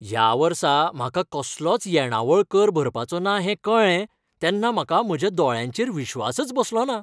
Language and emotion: Goan Konkani, happy